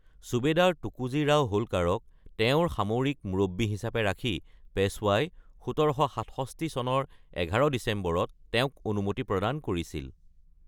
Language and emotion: Assamese, neutral